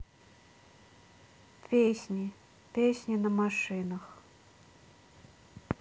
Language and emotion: Russian, neutral